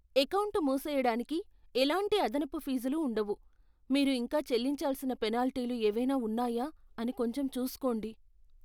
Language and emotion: Telugu, fearful